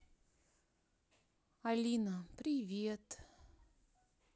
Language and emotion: Russian, sad